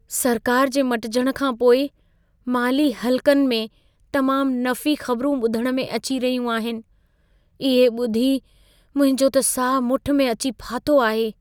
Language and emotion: Sindhi, fearful